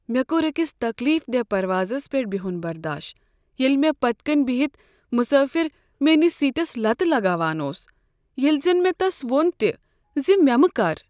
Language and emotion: Kashmiri, sad